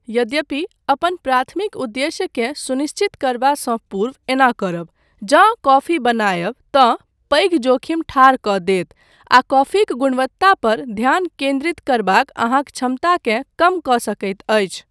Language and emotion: Maithili, neutral